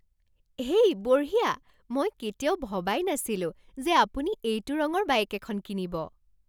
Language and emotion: Assamese, surprised